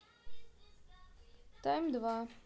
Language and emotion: Russian, neutral